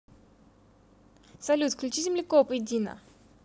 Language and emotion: Russian, positive